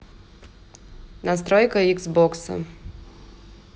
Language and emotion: Russian, neutral